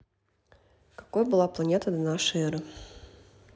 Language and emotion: Russian, neutral